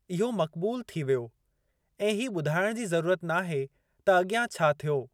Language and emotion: Sindhi, neutral